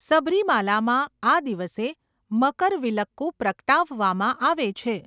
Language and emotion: Gujarati, neutral